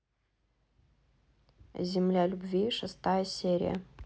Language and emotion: Russian, neutral